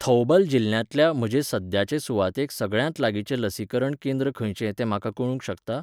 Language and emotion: Goan Konkani, neutral